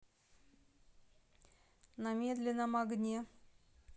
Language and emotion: Russian, neutral